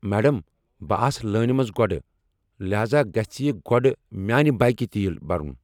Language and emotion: Kashmiri, angry